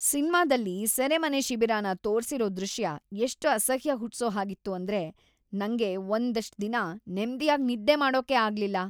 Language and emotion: Kannada, disgusted